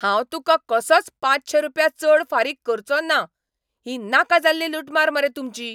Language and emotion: Goan Konkani, angry